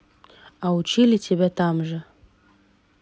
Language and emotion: Russian, neutral